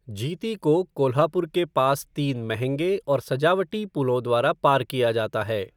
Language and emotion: Hindi, neutral